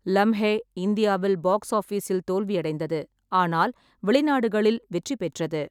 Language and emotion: Tamil, neutral